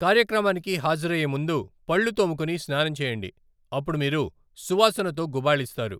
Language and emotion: Telugu, neutral